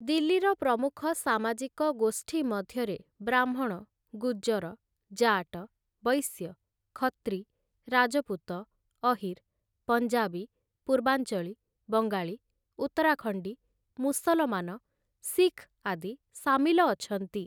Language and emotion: Odia, neutral